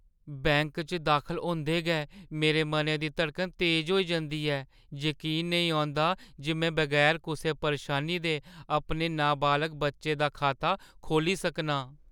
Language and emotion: Dogri, fearful